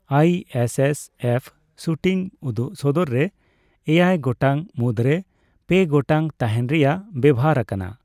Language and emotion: Santali, neutral